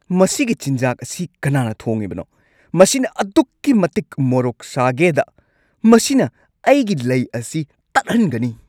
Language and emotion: Manipuri, angry